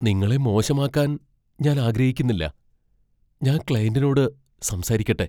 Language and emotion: Malayalam, fearful